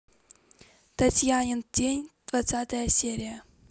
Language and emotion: Russian, neutral